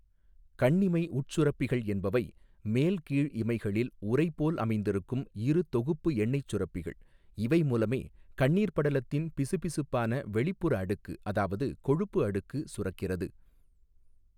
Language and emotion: Tamil, neutral